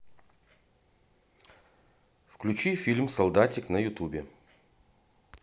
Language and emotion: Russian, neutral